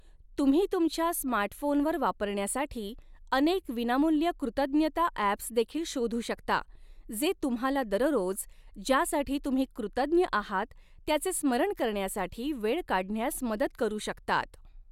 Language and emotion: Marathi, neutral